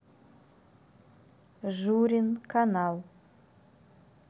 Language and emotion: Russian, neutral